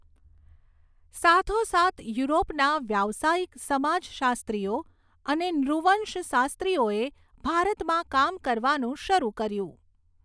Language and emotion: Gujarati, neutral